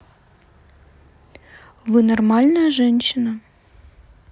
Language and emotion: Russian, neutral